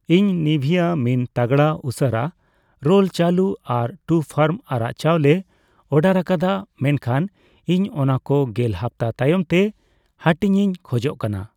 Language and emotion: Santali, neutral